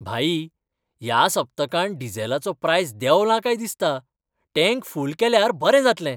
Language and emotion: Goan Konkani, happy